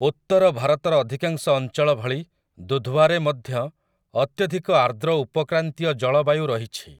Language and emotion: Odia, neutral